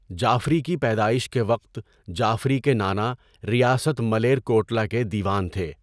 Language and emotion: Urdu, neutral